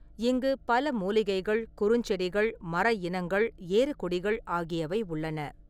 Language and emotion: Tamil, neutral